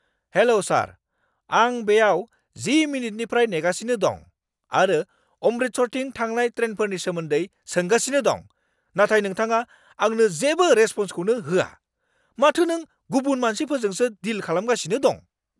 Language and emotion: Bodo, angry